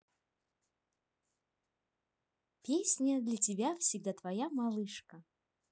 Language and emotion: Russian, positive